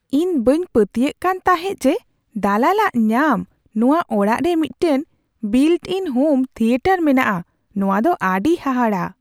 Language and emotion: Santali, surprised